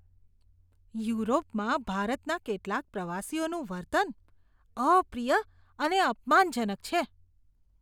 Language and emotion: Gujarati, disgusted